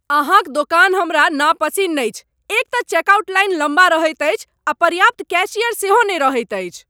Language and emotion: Maithili, angry